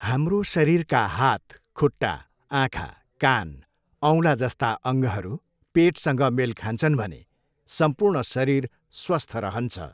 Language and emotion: Nepali, neutral